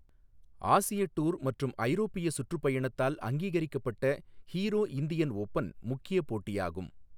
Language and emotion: Tamil, neutral